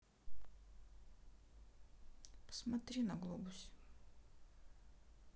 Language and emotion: Russian, sad